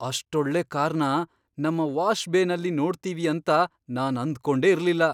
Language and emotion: Kannada, surprised